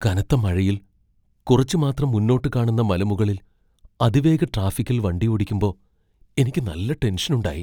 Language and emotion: Malayalam, fearful